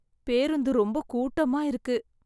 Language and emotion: Tamil, sad